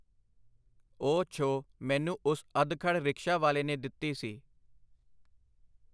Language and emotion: Punjabi, neutral